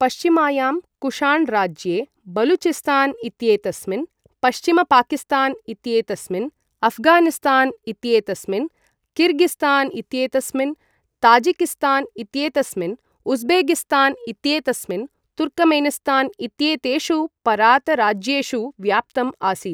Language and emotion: Sanskrit, neutral